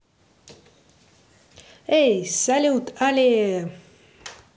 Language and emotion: Russian, positive